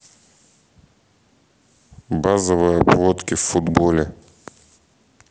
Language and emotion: Russian, neutral